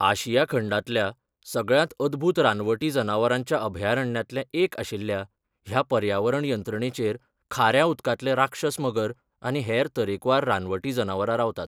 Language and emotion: Goan Konkani, neutral